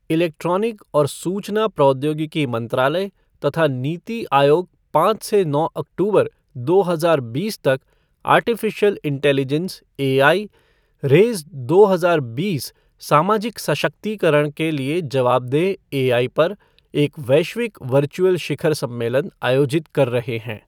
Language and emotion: Hindi, neutral